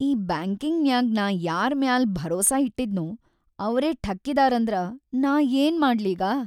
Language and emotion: Kannada, sad